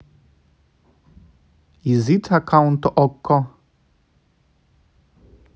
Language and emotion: Russian, neutral